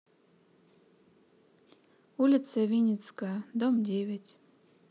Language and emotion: Russian, neutral